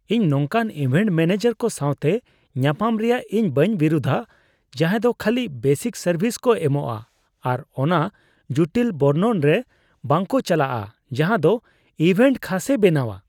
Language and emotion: Santali, disgusted